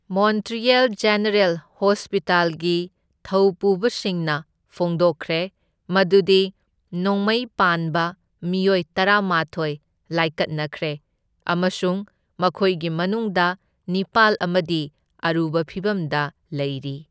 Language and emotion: Manipuri, neutral